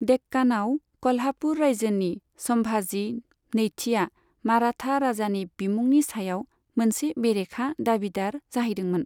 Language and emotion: Bodo, neutral